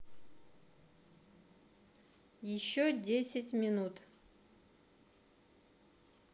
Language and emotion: Russian, neutral